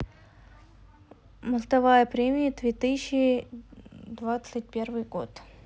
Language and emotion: Russian, neutral